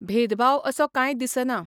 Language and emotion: Goan Konkani, neutral